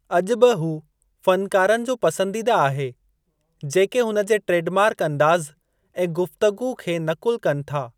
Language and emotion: Sindhi, neutral